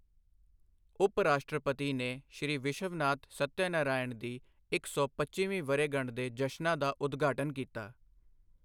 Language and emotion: Punjabi, neutral